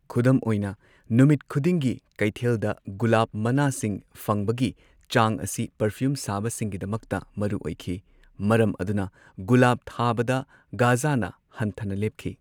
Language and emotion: Manipuri, neutral